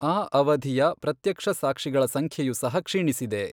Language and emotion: Kannada, neutral